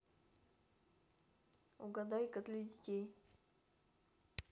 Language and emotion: Russian, neutral